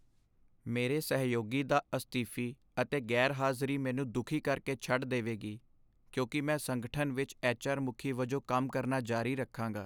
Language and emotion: Punjabi, sad